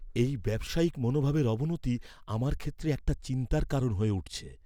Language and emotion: Bengali, fearful